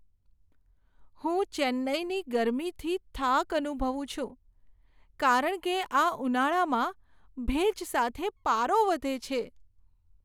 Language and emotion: Gujarati, sad